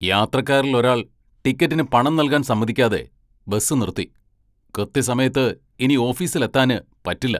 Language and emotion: Malayalam, angry